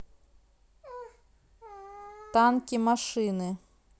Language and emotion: Russian, neutral